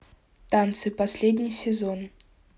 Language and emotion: Russian, neutral